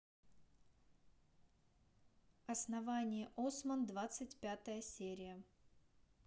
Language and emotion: Russian, neutral